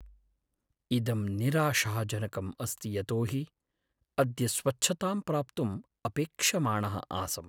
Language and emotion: Sanskrit, sad